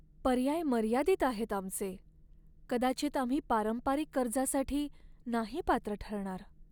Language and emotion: Marathi, sad